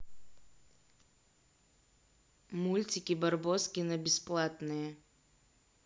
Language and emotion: Russian, neutral